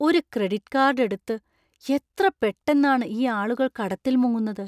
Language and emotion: Malayalam, surprised